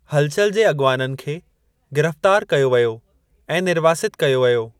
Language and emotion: Sindhi, neutral